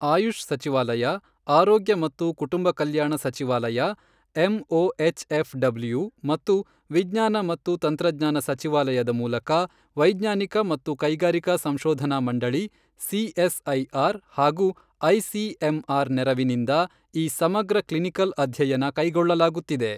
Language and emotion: Kannada, neutral